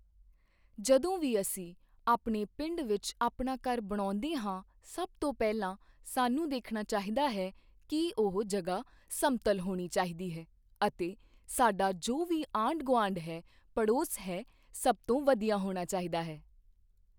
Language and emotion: Punjabi, neutral